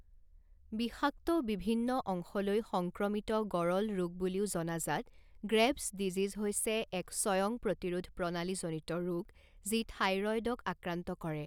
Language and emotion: Assamese, neutral